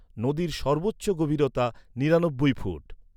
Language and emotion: Bengali, neutral